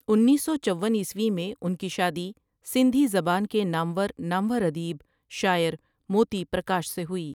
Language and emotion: Urdu, neutral